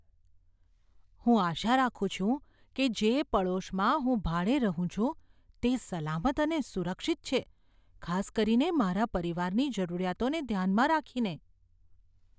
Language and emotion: Gujarati, fearful